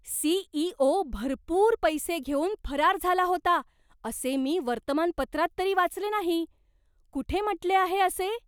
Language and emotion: Marathi, surprised